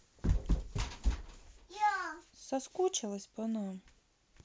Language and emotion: Russian, neutral